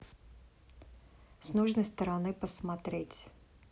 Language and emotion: Russian, neutral